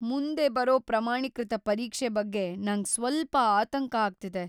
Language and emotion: Kannada, fearful